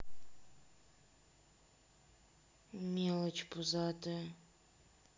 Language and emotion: Russian, sad